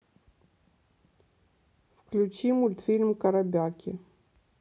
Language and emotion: Russian, neutral